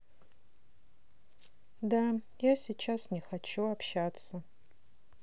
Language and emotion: Russian, sad